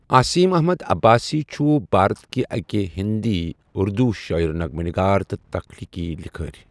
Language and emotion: Kashmiri, neutral